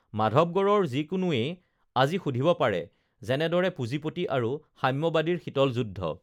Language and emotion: Assamese, neutral